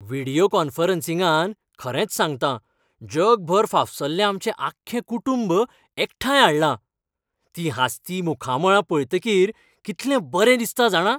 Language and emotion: Goan Konkani, happy